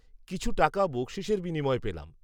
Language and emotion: Bengali, neutral